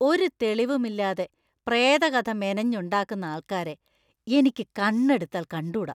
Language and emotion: Malayalam, disgusted